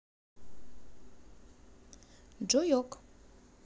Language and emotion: Russian, positive